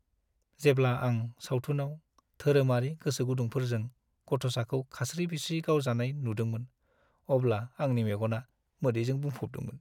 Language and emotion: Bodo, sad